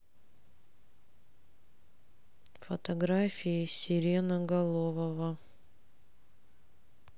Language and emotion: Russian, sad